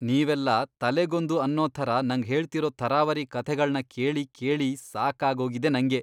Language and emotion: Kannada, disgusted